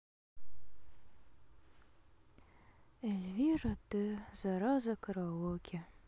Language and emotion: Russian, sad